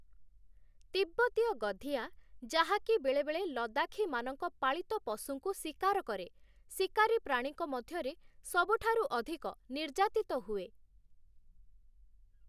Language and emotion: Odia, neutral